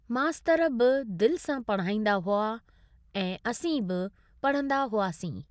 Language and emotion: Sindhi, neutral